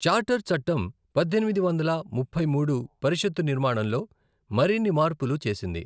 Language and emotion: Telugu, neutral